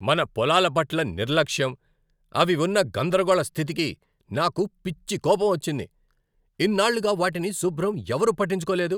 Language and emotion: Telugu, angry